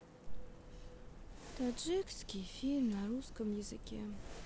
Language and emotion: Russian, sad